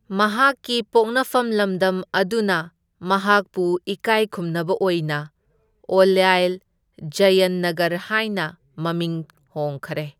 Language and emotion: Manipuri, neutral